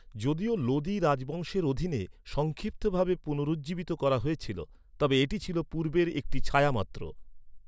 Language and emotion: Bengali, neutral